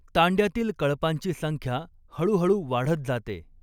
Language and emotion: Marathi, neutral